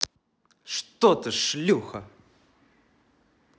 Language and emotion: Russian, neutral